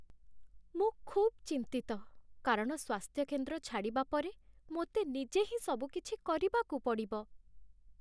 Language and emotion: Odia, sad